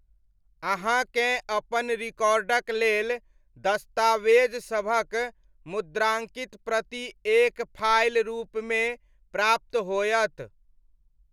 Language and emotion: Maithili, neutral